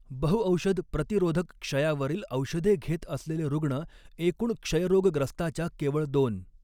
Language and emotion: Marathi, neutral